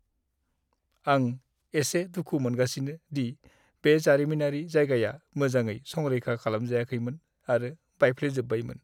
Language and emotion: Bodo, sad